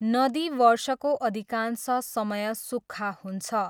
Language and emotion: Nepali, neutral